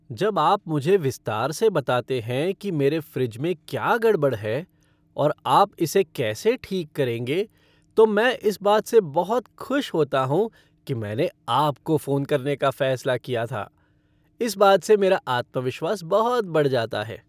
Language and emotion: Hindi, happy